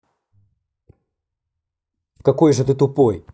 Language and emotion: Russian, angry